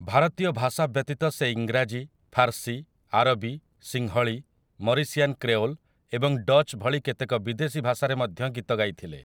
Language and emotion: Odia, neutral